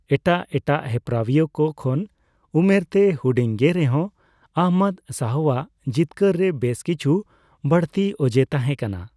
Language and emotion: Santali, neutral